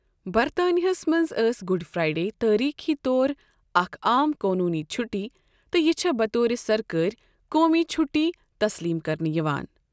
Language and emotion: Kashmiri, neutral